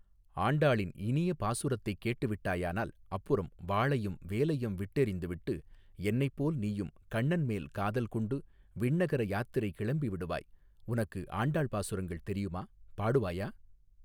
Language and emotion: Tamil, neutral